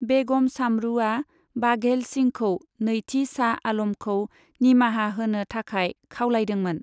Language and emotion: Bodo, neutral